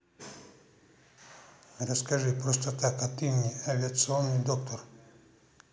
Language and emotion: Russian, neutral